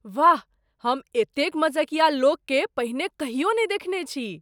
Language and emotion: Maithili, surprised